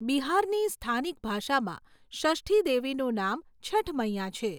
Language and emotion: Gujarati, neutral